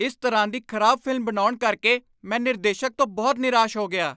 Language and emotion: Punjabi, angry